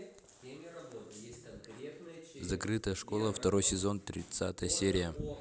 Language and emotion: Russian, neutral